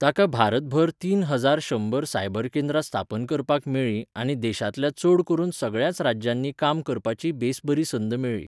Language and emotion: Goan Konkani, neutral